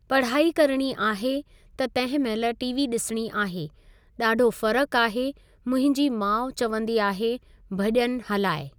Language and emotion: Sindhi, neutral